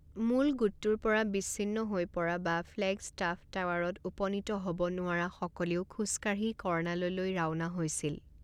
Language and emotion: Assamese, neutral